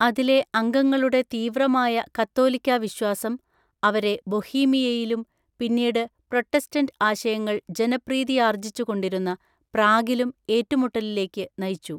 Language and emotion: Malayalam, neutral